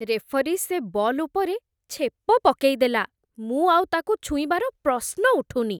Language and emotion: Odia, disgusted